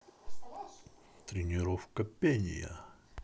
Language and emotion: Russian, positive